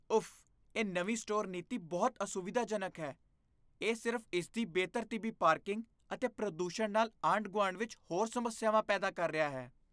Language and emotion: Punjabi, disgusted